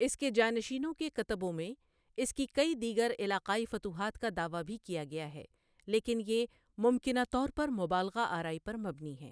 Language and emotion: Urdu, neutral